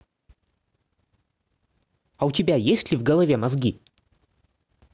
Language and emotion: Russian, angry